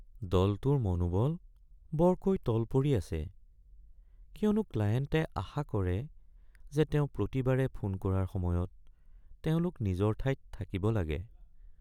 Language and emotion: Assamese, sad